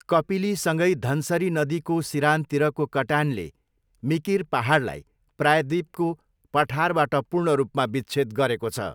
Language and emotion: Nepali, neutral